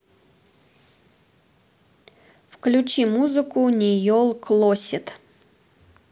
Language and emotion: Russian, neutral